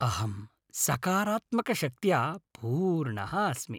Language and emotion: Sanskrit, happy